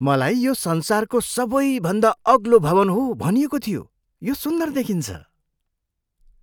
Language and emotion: Nepali, surprised